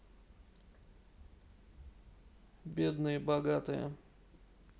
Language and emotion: Russian, neutral